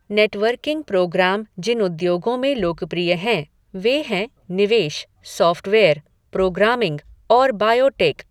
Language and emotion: Hindi, neutral